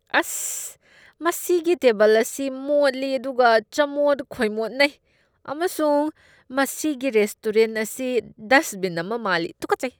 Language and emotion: Manipuri, disgusted